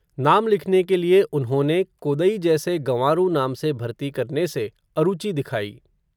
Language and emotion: Hindi, neutral